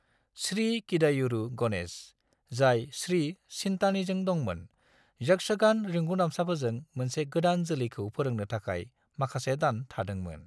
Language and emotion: Bodo, neutral